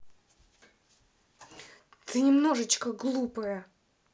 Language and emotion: Russian, angry